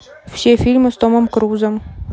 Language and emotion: Russian, neutral